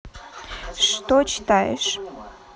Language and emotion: Russian, neutral